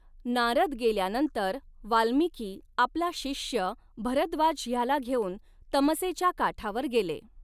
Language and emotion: Marathi, neutral